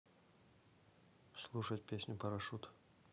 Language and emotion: Russian, neutral